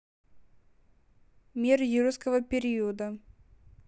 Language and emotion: Russian, neutral